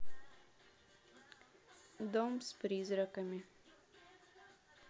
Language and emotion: Russian, neutral